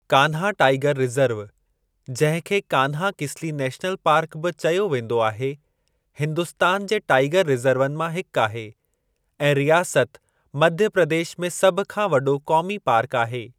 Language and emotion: Sindhi, neutral